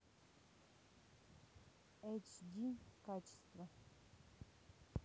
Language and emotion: Russian, neutral